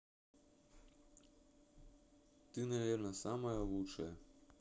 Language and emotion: Russian, neutral